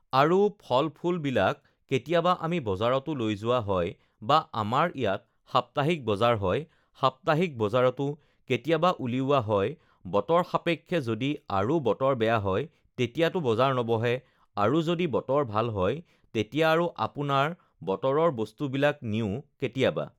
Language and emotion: Assamese, neutral